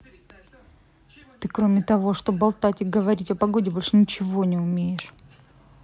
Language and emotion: Russian, angry